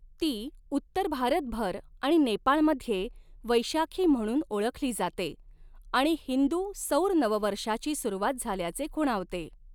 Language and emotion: Marathi, neutral